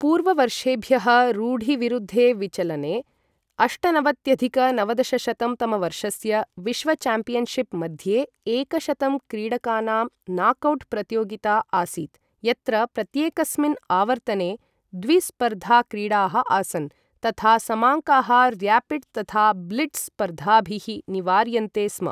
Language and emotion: Sanskrit, neutral